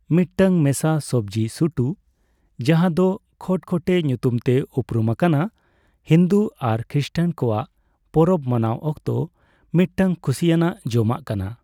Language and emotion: Santali, neutral